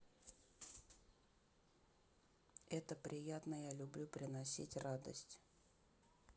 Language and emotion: Russian, neutral